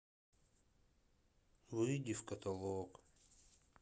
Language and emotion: Russian, sad